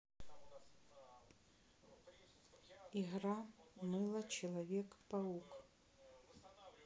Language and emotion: Russian, neutral